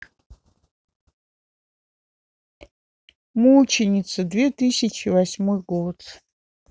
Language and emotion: Russian, sad